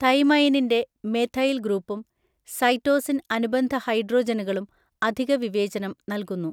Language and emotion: Malayalam, neutral